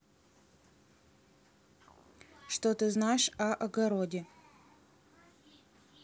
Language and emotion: Russian, neutral